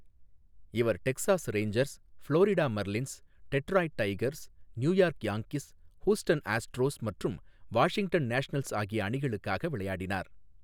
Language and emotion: Tamil, neutral